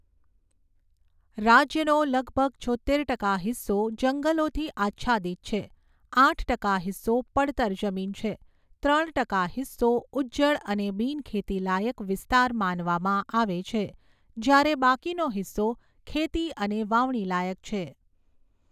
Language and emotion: Gujarati, neutral